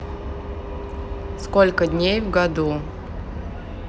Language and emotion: Russian, neutral